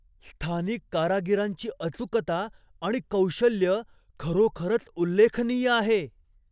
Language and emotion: Marathi, surprised